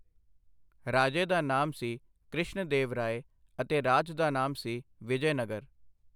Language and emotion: Punjabi, neutral